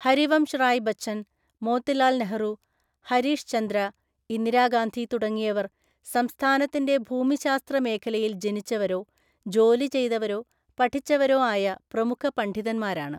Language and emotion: Malayalam, neutral